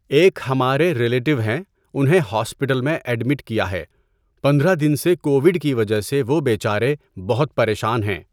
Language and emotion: Urdu, neutral